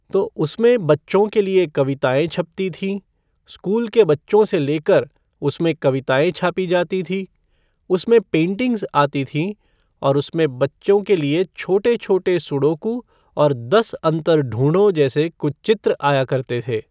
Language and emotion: Hindi, neutral